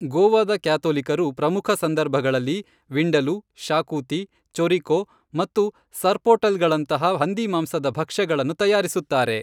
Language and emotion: Kannada, neutral